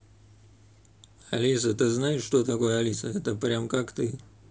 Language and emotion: Russian, neutral